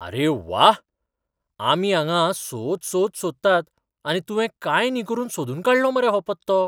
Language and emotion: Goan Konkani, surprised